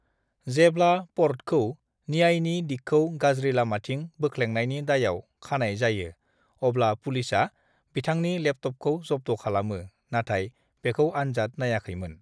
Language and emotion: Bodo, neutral